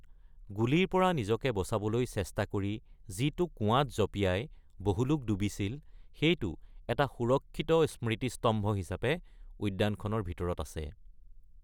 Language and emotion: Assamese, neutral